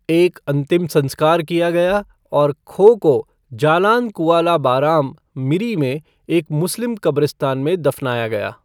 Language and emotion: Hindi, neutral